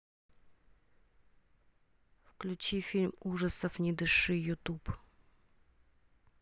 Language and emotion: Russian, neutral